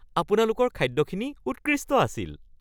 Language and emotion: Assamese, happy